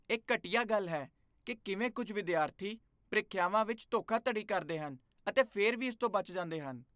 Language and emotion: Punjabi, disgusted